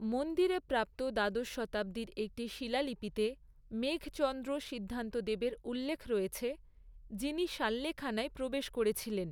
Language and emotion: Bengali, neutral